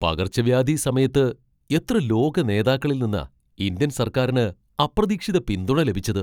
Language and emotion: Malayalam, surprised